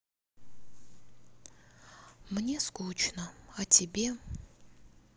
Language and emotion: Russian, sad